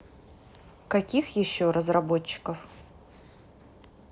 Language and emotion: Russian, neutral